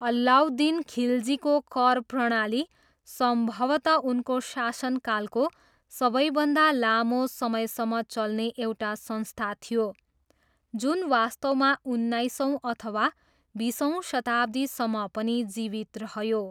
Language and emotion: Nepali, neutral